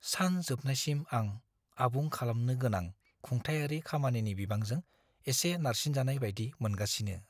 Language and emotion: Bodo, fearful